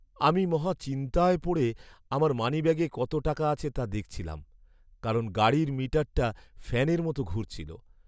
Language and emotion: Bengali, sad